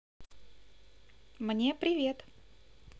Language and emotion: Russian, positive